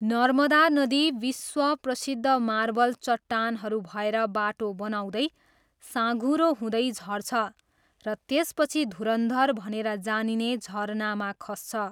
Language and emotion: Nepali, neutral